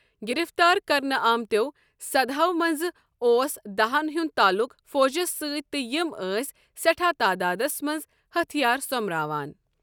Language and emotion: Kashmiri, neutral